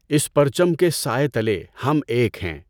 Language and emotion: Urdu, neutral